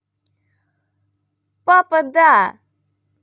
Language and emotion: Russian, positive